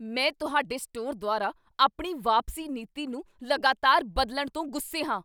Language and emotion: Punjabi, angry